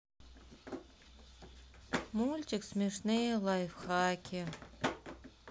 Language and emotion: Russian, sad